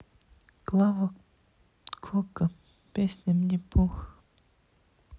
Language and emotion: Russian, sad